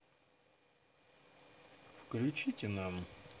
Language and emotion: Russian, neutral